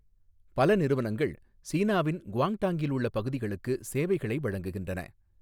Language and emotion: Tamil, neutral